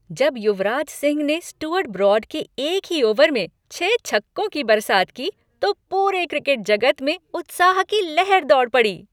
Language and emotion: Hindi, happy